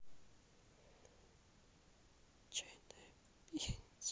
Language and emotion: Russian, sad